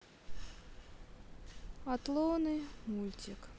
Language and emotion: Russian, sad